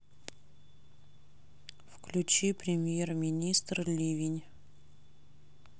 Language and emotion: Russian, neutral